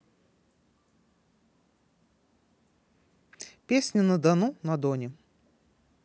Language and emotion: Russian, neutral